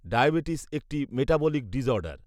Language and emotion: Bengali, neutral